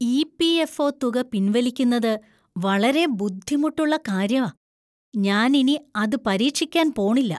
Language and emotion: Malayalam, disgusted